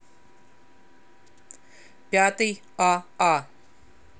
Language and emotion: Russian, neutral